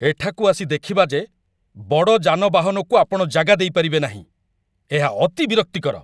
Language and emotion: Odia, angry